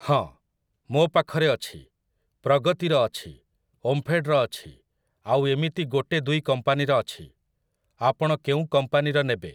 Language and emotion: Odia, neutral